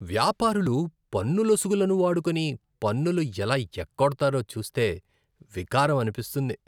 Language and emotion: Telugu, disgusted